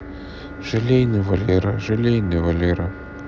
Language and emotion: Russian, sad